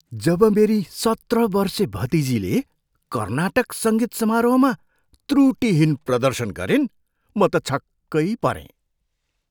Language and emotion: Nepali, surprised